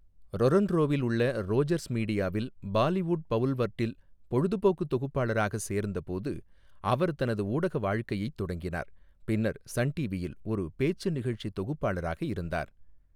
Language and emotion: Tamil, neutral